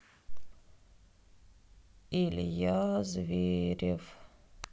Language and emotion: Russian, sad